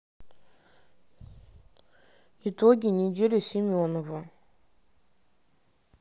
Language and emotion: Russian, sad